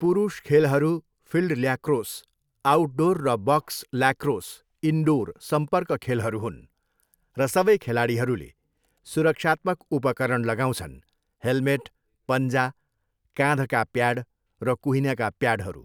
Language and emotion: Nepali, neutral